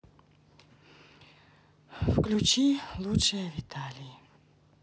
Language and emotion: Russian, sad